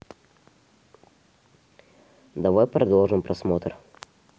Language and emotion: Russian, neutral